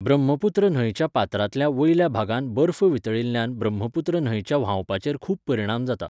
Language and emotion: Goan Konkani, neutral